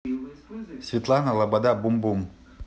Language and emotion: Russian, neutral